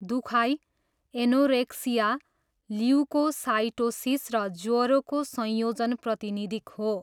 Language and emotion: Nepali, neutral